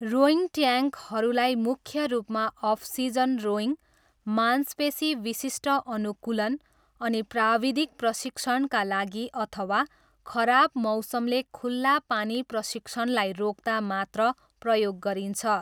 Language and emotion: Nepali, neutral